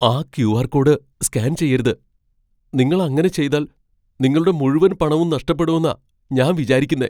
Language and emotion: Malayalam, fearful